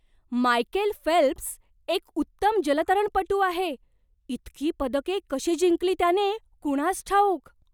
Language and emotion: Marathi, surprised